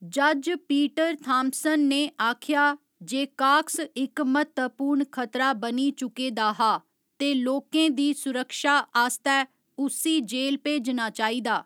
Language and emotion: Dogri, neutral